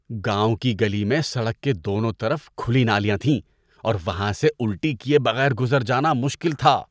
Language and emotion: Urdu, disgusted